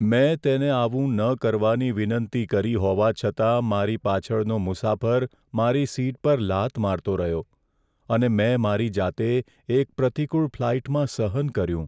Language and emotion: Gujarati, sad